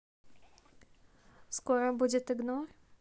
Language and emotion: Russian, neutral